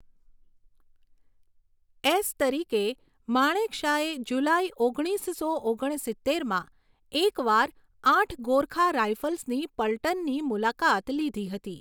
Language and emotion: Gujarati, neutral